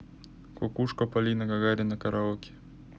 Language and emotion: Russian, neutral